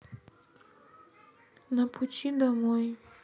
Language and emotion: Russian, sad